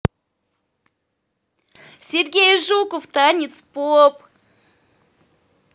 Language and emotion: Russian, positive